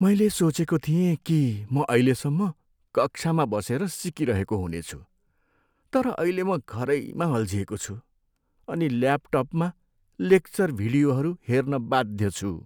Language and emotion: Nepali, sad